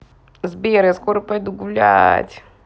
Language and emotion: Russian, positive